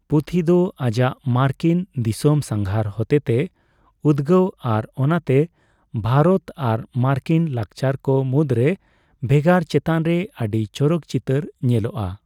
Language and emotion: Santali, neutral